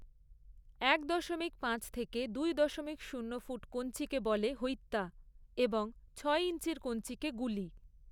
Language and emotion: Bengali, neutral